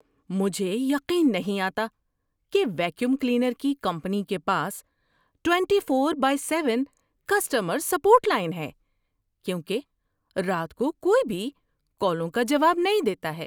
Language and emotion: Urdu, surprised